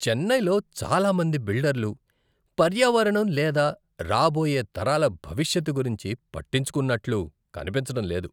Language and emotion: Telugu, disgusted